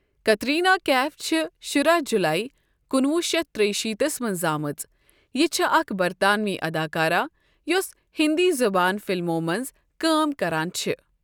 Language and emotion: Kashmiri, neutral